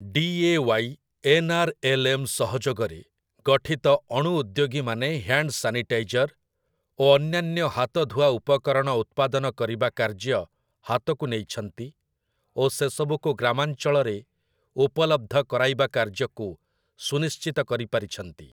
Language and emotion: Odia, neutral